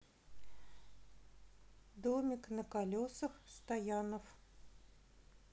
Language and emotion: Russian, neutral